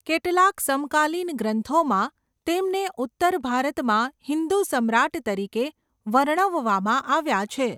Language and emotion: Gujarati, neutral